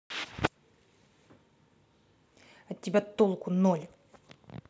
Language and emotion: Russian, angry